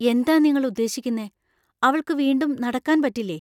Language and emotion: Malayalam, fearful